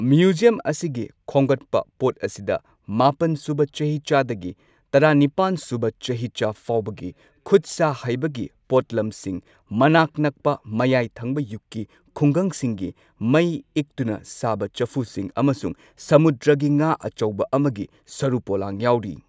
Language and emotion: Manipuri, neutral